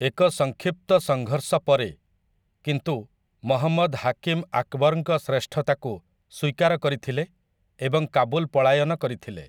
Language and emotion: Odia, neutral